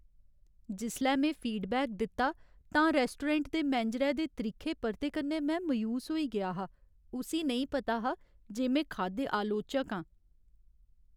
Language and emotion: Dogri, sad